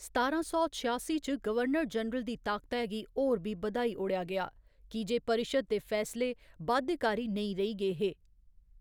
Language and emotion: Dogri, neutral